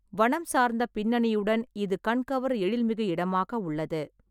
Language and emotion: Tamil, neutral